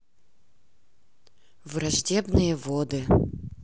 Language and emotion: Russian, neutral